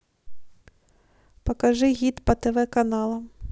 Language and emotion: Russian, neutral